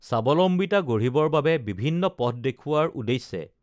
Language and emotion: Assamese, neutral